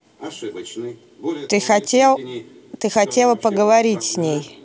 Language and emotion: Russian, neutral